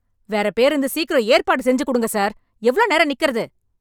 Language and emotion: Tamil, angry